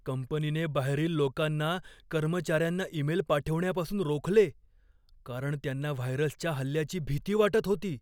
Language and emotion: Marathi, fearful